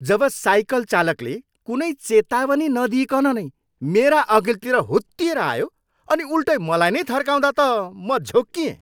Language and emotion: Nepali, angry